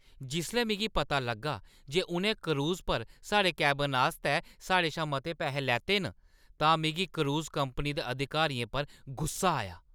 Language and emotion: Dogri, angry